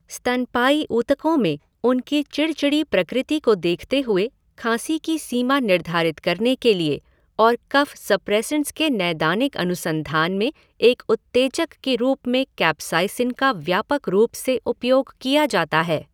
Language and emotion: Hindi, neutral